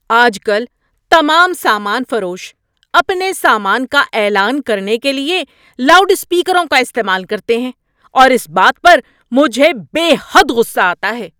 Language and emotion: Urdu, angry